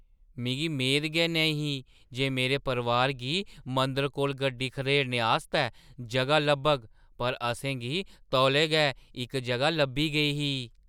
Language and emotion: Dogri, surprised